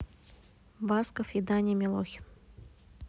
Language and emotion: Russian, neutral